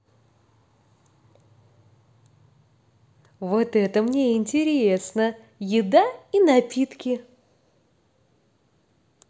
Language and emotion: Russian, positive